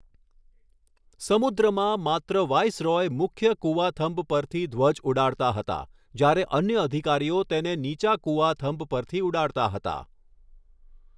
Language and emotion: Gujarati, neutral